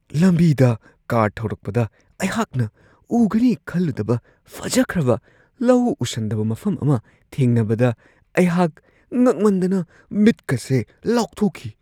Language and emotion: Manipuri, surprised